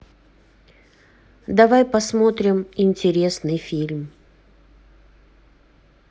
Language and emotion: Russian, neutral